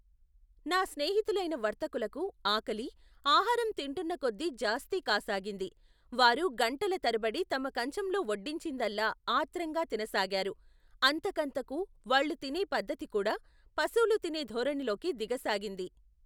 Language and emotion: Telugu, neutral